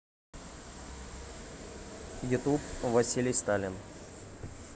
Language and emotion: Russian, neutral